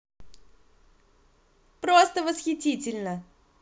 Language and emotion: Russian, positive